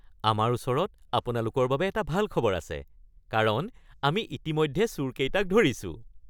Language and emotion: Assamese, happy